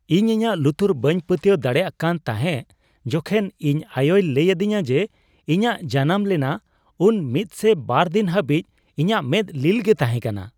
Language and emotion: Santali, surprised